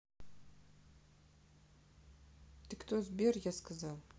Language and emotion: Russian, neutral